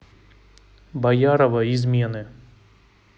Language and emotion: Russian, neutral